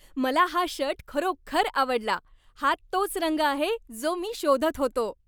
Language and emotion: Marathi, happy